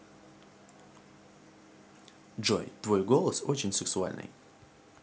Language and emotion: Russian, positive